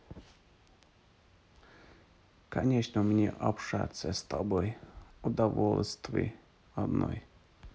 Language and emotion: Russian, neutral